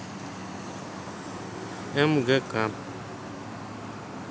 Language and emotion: Russian, neutral